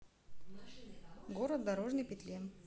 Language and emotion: Russian, neutral